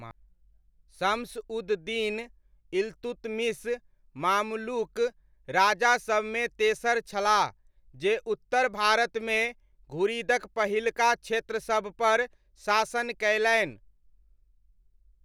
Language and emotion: Maithili, neutral